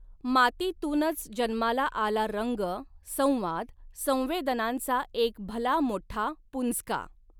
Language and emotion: Marathi, neutral